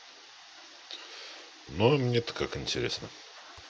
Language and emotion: Russian, neutral